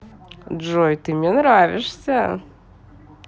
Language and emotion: Russian, positive